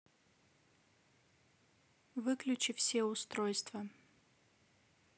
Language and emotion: Russian, neutral